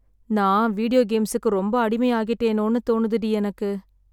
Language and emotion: Tamil, sad